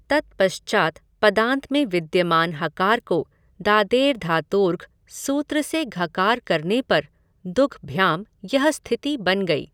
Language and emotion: Hindi, neutral